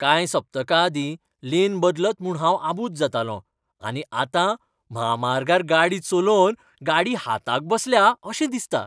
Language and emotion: Goan Konkani, happy